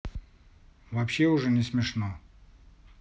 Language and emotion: Russian, neutral